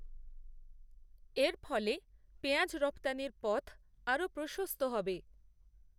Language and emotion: Bengali, neutral